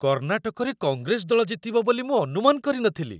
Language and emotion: Odia, surprised